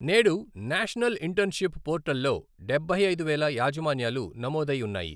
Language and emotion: Telugu, neutral